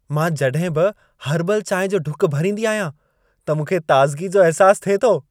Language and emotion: Sindhi, happy